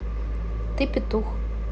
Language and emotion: Russian, neutral